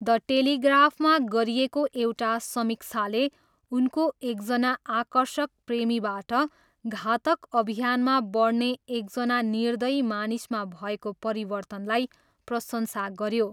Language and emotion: Nepali, neutral